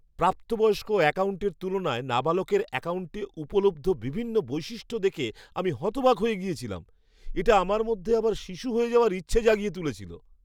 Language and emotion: Bengali, surprised